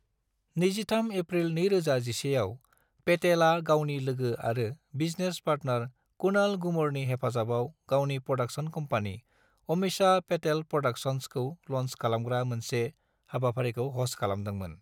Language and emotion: Bodo, neutral